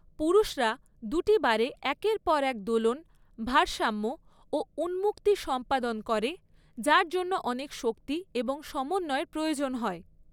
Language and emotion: Bengali, neutral